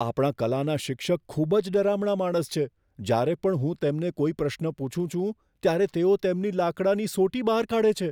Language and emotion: Gujarati, fearful